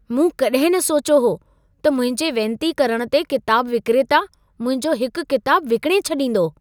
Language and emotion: Sindhi, surprised